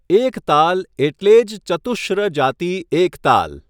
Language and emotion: Gujarati, neutral